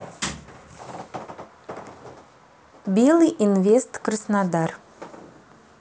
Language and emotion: Russian, neutral